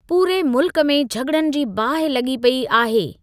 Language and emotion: Sindhi, neutral